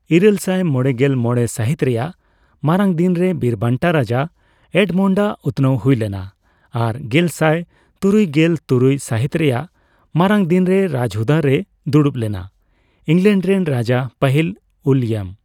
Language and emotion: Santali, neutral